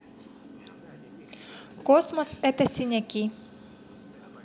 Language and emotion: Russian, neutral